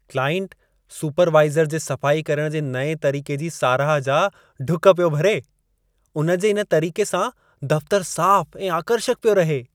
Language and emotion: Sindhi, happy